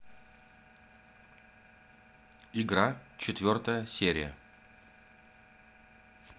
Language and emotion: Russian, neutral